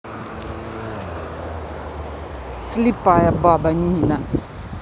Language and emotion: Russian, angry